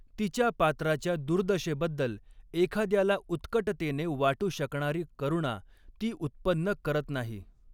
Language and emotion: Marathi, neutral